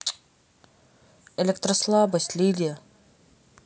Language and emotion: Russian, neutral